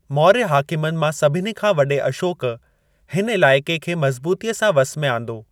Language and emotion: Sindhi, neutral